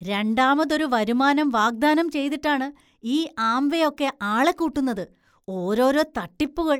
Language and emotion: Malayalam, disgusted